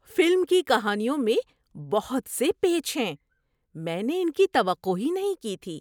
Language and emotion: Urdu, surprised